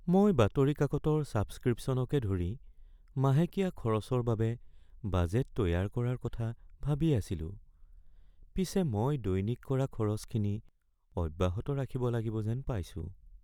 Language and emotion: Assamese, sad